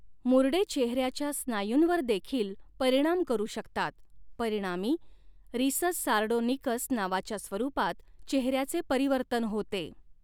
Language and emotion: Marathi, neutral